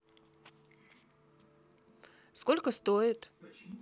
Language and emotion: Russian, neutral